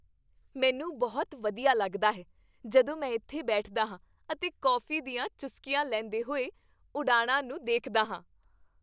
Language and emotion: Punjabi, happy